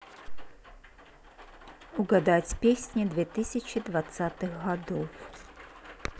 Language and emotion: Russian, neutral